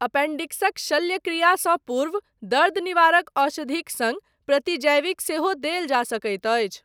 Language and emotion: Maithili, neutral